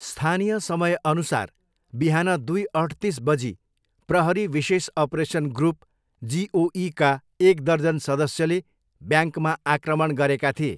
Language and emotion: Nepali, neutral